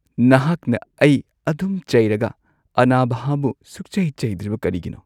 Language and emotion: Manipuri, sad